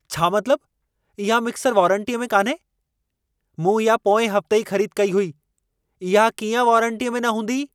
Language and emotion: Sindhi, angry